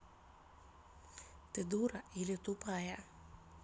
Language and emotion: Russian, angry